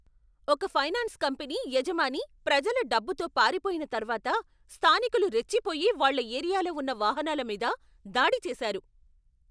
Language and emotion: Telugu, angry